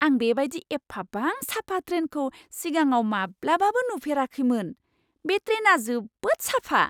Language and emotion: Bodo, surprised